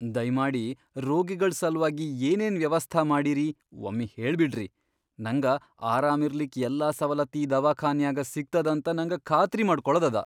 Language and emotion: Kannada, fearful